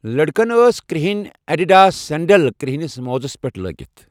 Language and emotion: Kashmiri, neutral